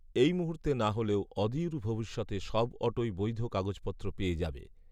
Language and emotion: Bengali, neutral